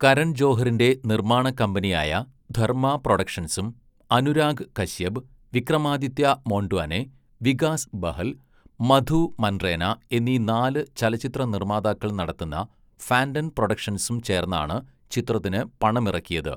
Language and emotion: Malayalam, neutral